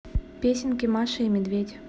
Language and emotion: Russian, neutral